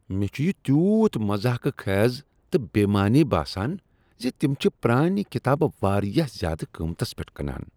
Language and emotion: Kashmiri, disgusted